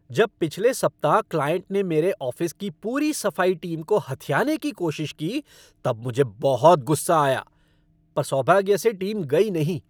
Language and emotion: Hindi, angry